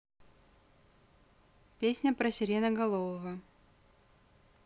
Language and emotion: Russian, neutral